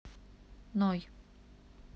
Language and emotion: Russian, neutral